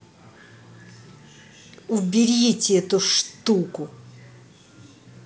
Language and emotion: Russian, angry